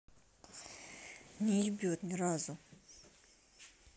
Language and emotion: Russian, angry